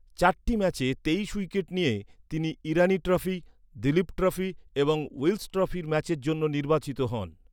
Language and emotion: Bengali, neutral